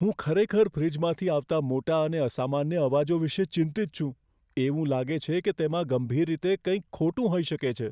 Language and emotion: Gujarati, fearful